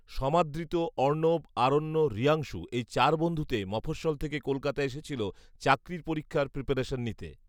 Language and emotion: Bengali, neutral